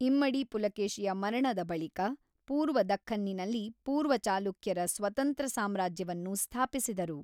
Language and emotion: Kannada, neutral